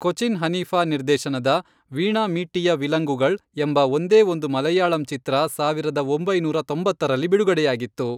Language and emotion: Kannada, neutral